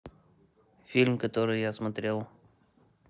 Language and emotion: Russian, neutral